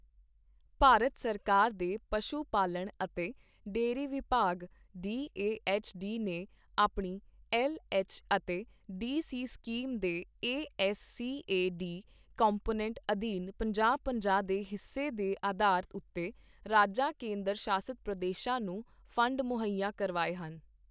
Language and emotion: Punjabi, neutral